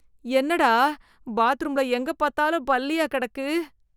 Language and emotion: Tamil, disgusted